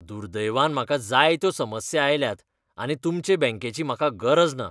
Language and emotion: Goan Konkani, disgusted